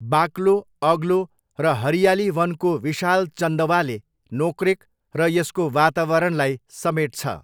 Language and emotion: Nepali, neutral